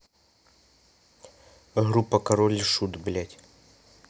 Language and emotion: Russian, neutral